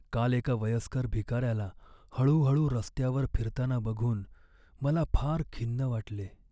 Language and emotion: Marathi, sad